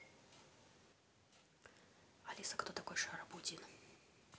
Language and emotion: Russian, neutral